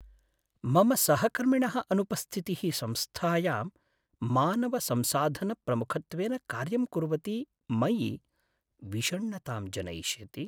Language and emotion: Sanskrit, sad